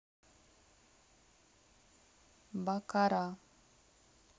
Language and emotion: Russian, neutral